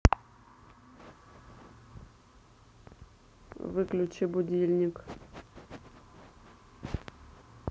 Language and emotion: Russian, neutral